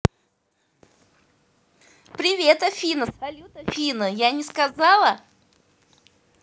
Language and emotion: Russian, positive